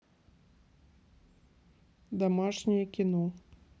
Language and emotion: Russian, neutral